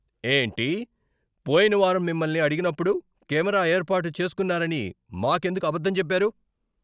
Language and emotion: Telugu, angry